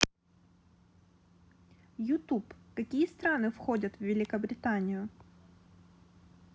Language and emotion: Russian, neutral